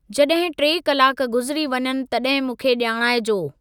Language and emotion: Sindhi, neutral